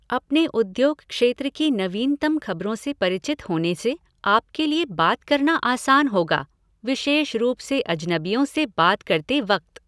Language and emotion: Hindi, neutral